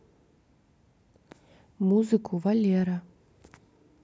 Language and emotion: Russian, neutral